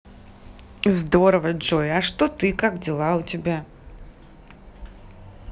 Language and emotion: Russian, positive